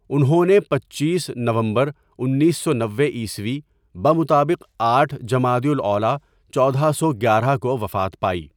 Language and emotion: Urdu, neutral